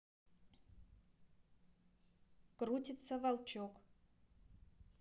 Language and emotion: Russian, neutral